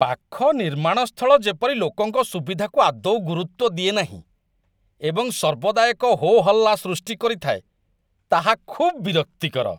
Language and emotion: Odia, disgusted